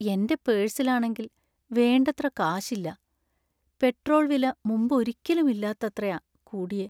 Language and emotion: Malayalam, sad